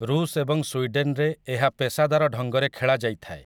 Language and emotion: Odia, neutral